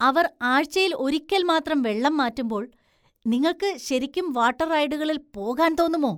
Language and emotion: Malayalam, disgusted